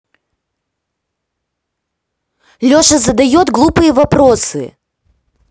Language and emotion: Russian, angry